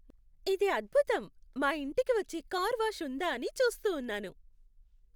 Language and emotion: Telugu, happy